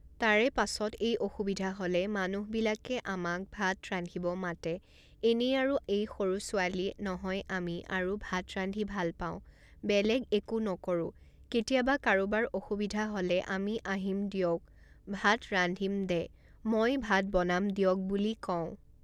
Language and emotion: Assamese, neutral